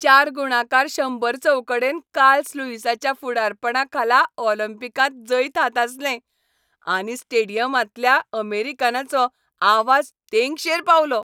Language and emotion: Goan Konkani, happy